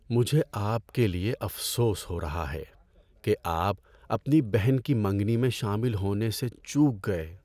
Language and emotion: Urdu, sad